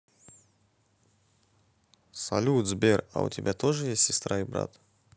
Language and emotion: Russian, neutral